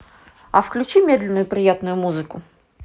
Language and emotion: Russian, neutral